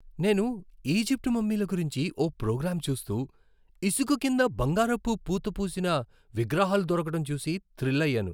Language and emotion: Telugu, happy